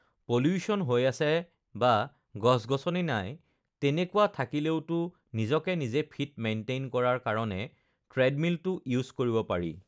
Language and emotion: Assamese, neutral